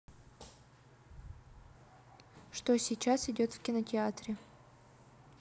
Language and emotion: Russian, neutral